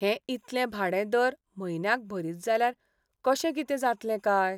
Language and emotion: Goan Konkani, sad